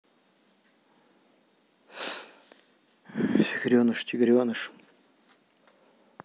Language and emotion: Russian, neutral